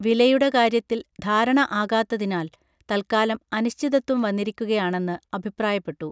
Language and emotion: Malayalam, neutral